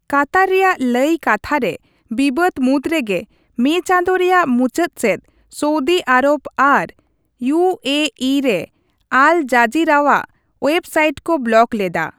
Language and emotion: Santali, neutral